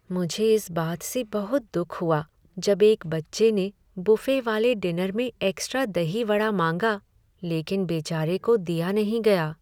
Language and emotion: Hindi, sad